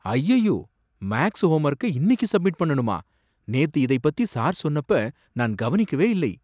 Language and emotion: Tamil, surprised